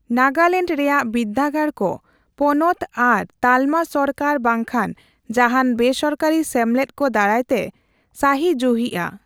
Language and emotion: Santali, neutral